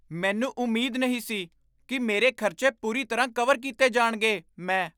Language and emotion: Punjabi, surprised